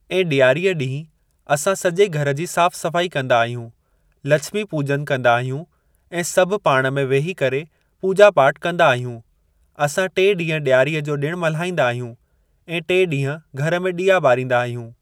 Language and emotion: Sindhi, neutral